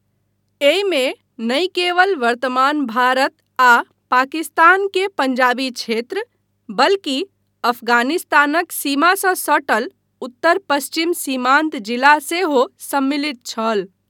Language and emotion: Maithili, neutral